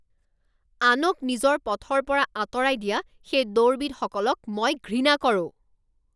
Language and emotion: Assamese, angry